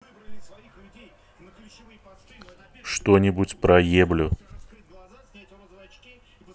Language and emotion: Russian, neutral